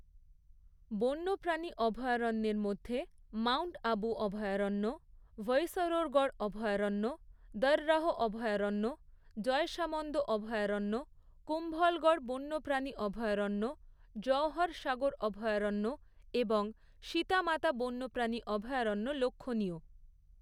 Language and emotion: Bengali, neutral